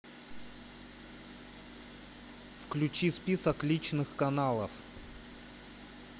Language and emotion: Russian, neutral